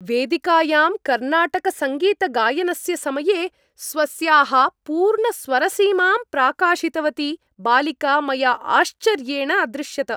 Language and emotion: Sanskrit, happy